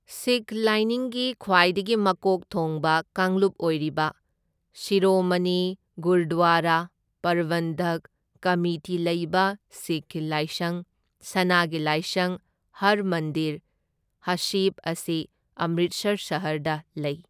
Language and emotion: Manipuri, neutral